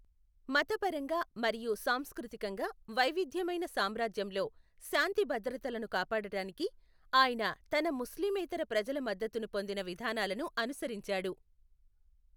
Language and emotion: Telugu, neutral